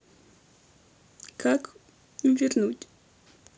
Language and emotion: Russian, sad